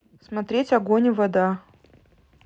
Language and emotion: Russian, neutral